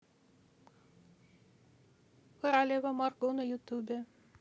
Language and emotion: Russian, neutral